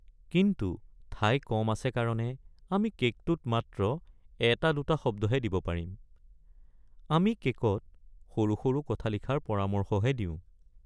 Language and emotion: Assamese, sad